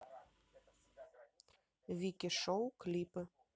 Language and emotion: Russian, neutral